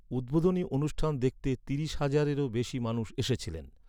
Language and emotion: Bengali, neutral